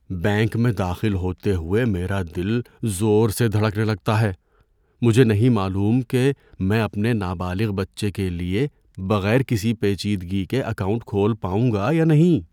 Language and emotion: Urdu, fearful